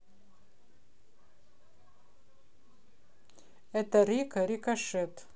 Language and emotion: Russian, neutral